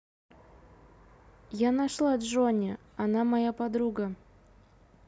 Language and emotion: Russian, neutral